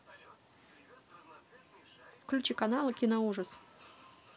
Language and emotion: Russian, neutral